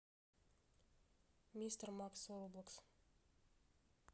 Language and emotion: Russian, neutral